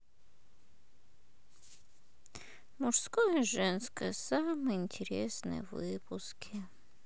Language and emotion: Russian, sad